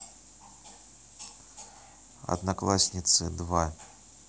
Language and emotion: Russian, neutral